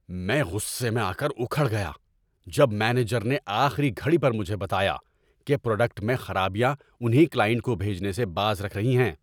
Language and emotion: Urdu, angry